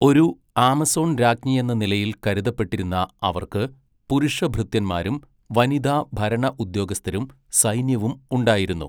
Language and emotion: Malayalam, neutral